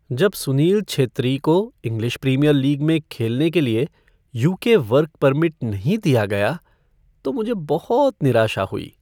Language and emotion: Hindi, sad